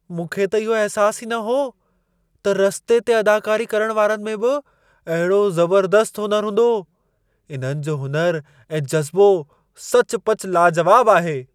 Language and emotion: Sindhi, surprised